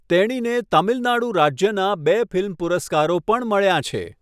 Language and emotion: Gujarati, neutral